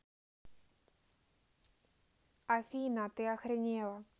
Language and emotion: Russian, neutral